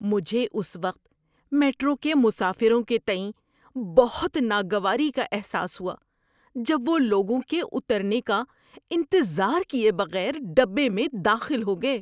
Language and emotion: Urdu, disgusted